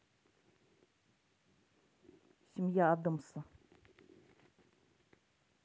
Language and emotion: Russian, neutral